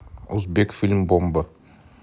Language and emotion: Russian, neutral